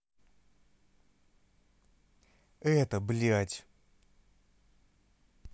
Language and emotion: Russian, neutral